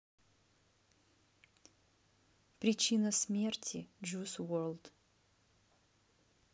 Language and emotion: Russian, neutral